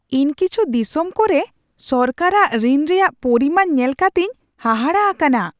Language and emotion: Santali, surprised